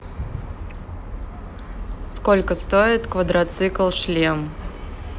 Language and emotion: Russian, neutral